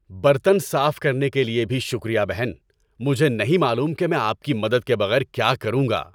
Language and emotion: Urdu, happy